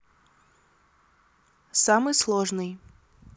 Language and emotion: Russian, neutral